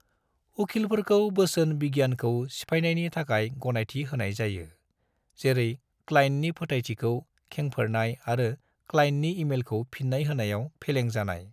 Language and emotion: Bodo, neutral